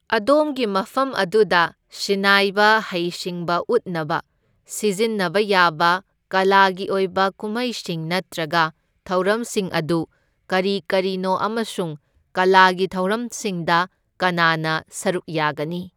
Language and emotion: Manipuri, neutral